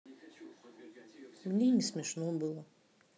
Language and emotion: Russian, sad